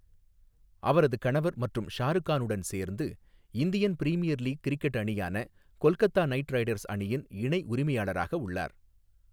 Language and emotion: Tamil, neutral